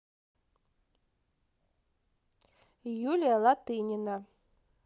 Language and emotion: Russian, neutral